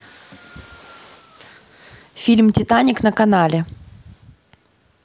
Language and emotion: Russian, neutral